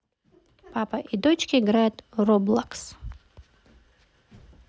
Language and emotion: Russian, neutral